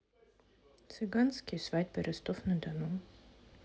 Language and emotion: Russian, neutral